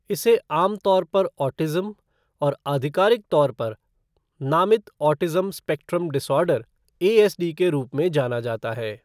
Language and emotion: Hindi, neutral